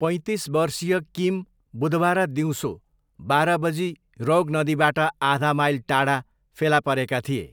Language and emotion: Nepali, neutral